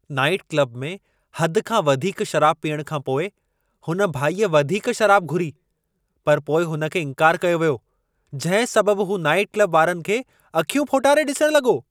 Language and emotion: Sindhi, angry